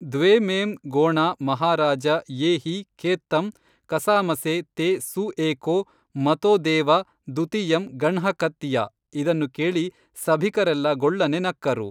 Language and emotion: Kannada, neutral